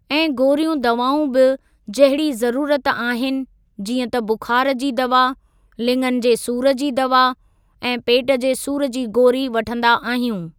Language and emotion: Sindhi, neutral